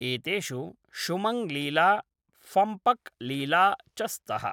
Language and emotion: Sanskrit, neutral